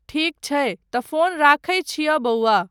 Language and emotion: Maithili, neutral